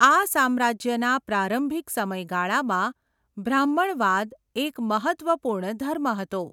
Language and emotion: Gujarati, neutral